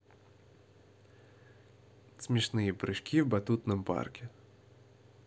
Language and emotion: Russian, positive